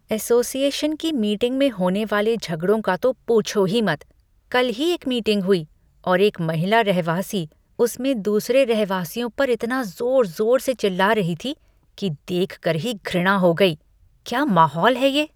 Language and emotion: Hindi, disgusted